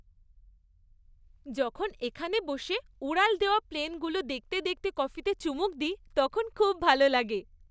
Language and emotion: Bengali, happy